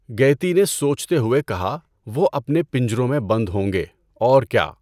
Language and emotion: Urdu, neutral